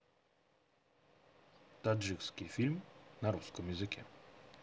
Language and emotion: Russian, neutral